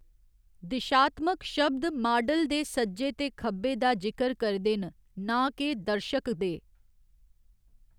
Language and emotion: Dogri, neutral